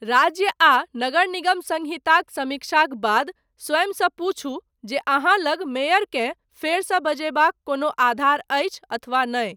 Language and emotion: Maithili, neutral